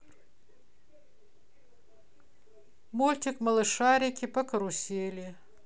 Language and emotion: Russian, neutral